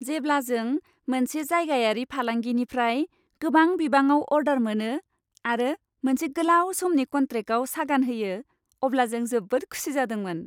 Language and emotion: Bodo, happy